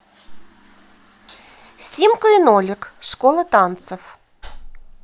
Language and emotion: Russian, positive